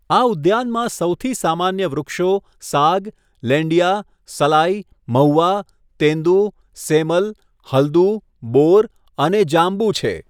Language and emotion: Gujarati, neutral